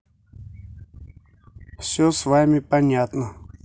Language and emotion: Russian, neutral